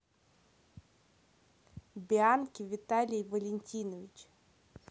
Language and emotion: Russian, neutral